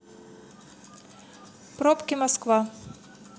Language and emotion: Russian, neutral